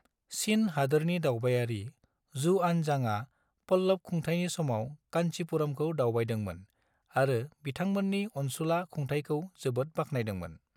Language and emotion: Bodo, neutral